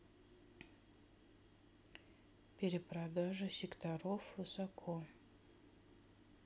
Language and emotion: Russian, neutral